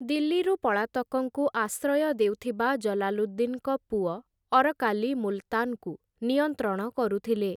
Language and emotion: Odia, neutral